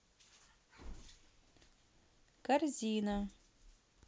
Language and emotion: Russian, neutral